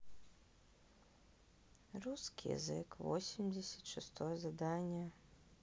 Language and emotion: Russian, sad